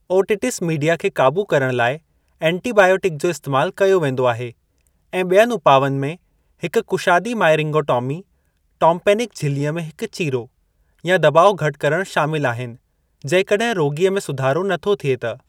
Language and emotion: Sindhi, neutral